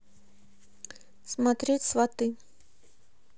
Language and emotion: Russian, neutral